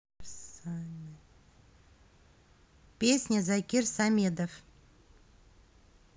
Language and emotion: Russian, neutral